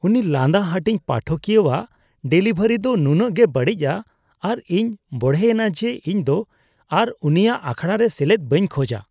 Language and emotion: Santali, disgusted